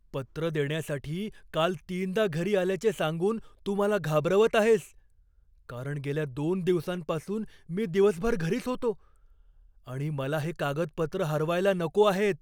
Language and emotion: Marathi, fearful